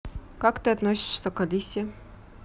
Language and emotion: Russian, neutral